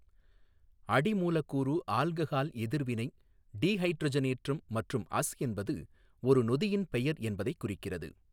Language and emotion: Tamil, neutral